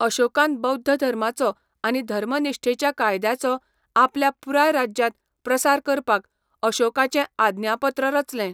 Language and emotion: Goan Konkani, neutral